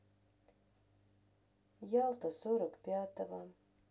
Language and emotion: Russian, sad